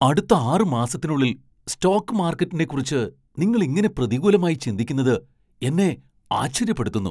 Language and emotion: Malayalam, surprised